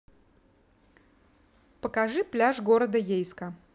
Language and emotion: Russian, neutral